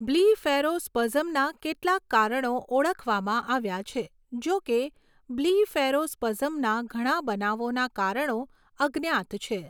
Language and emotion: Gujarati, neutral